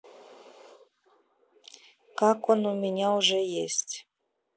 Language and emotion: Russian, neutral